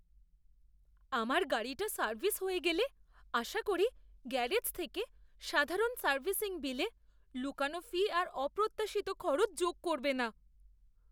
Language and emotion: Bengali, fearful